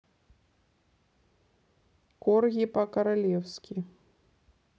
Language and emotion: Russian, neutral